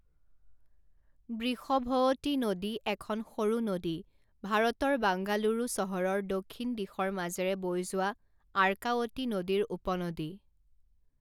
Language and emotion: Assamese, neutral